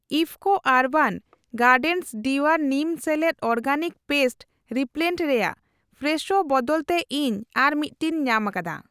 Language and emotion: Santali, neutral